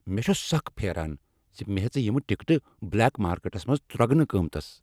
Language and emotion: Kashmiri, angry